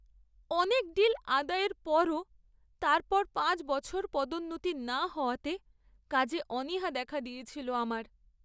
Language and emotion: Bengali, sad